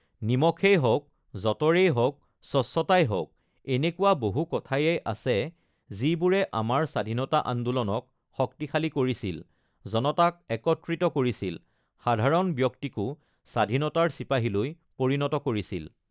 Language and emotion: Assamese, neutral